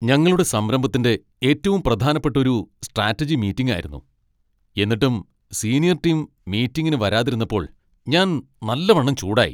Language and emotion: Malayalam, angry